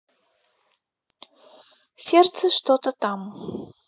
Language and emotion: Russian, neutral